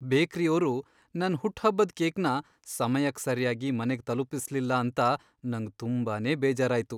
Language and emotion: Kannada, sad